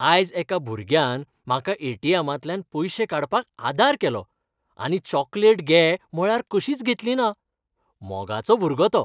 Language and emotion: Goan Konkani, happy